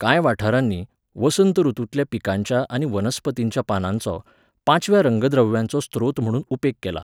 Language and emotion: Goan Konkani, neutral